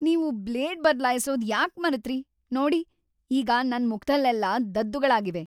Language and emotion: Kannada, angry